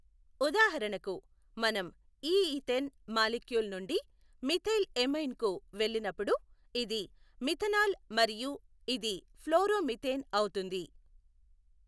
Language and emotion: Telugu, neutral